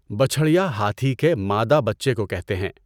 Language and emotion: Urdu, neutral